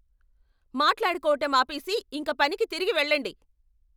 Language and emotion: Telugu, angry